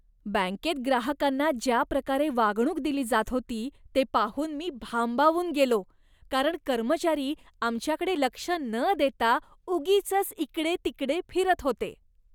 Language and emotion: Marathi, disgusted